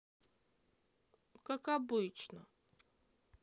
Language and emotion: Russian, sad